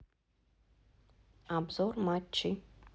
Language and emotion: Russian, neutral